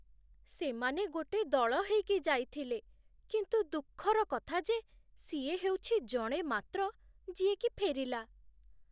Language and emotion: Odia, sad